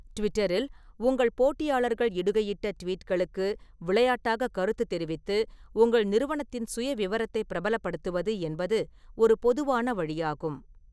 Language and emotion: Tamil, neutral